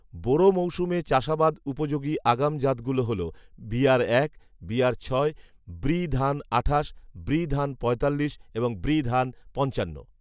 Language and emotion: Bengali, neutral